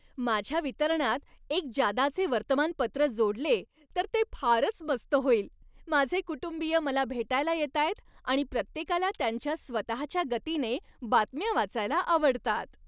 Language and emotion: Marathi, happy